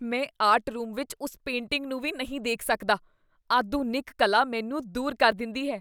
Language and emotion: Punjabi, disgusted